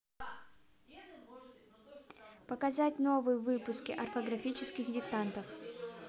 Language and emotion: Russian, neutral